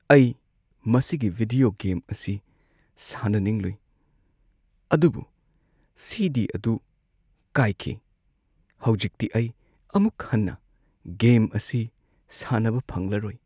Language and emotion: Manipuri, sad